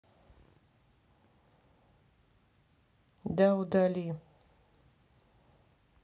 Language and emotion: Russian, neutral